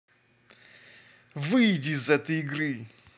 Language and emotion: Russian, angry